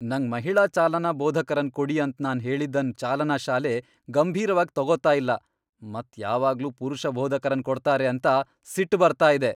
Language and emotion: Kannada, angry